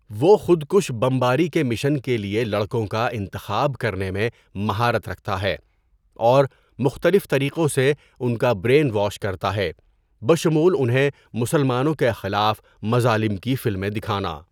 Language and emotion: Urdu, neutral